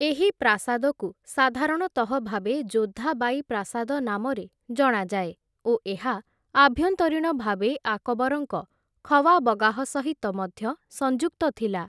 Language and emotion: Odia, neutral